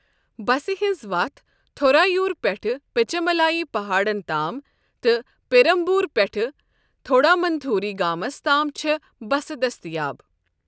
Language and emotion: Kashmiri, neutral